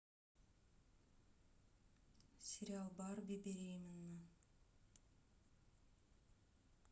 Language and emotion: Russian, neutral